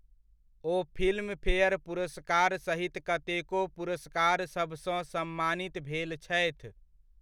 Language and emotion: Maithili, neutral